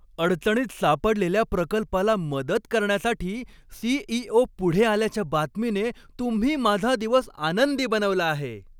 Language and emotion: Marathi, happy